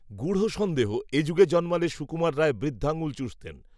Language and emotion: Bengali, neutral